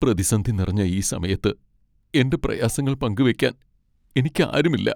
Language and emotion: Malayalam, sad